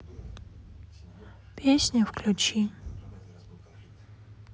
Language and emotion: Russian, sad